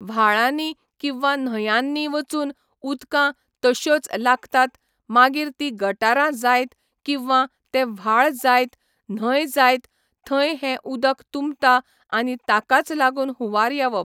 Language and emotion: Goan Konkani, neutral